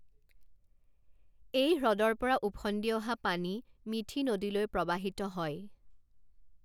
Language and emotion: Assamese, neutral